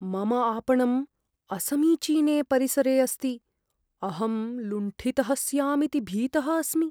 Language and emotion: Sanskrit, fearful